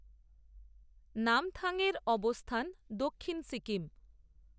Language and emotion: Bengali, neutral